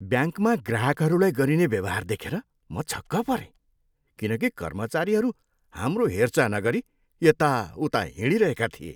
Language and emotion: Nepali, disgusted